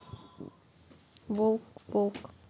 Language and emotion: Russian, neutral